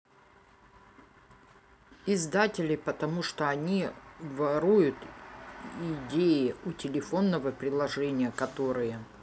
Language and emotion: Russian, neutral